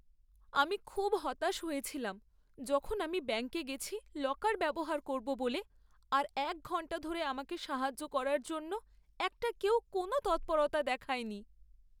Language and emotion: Bengali, sad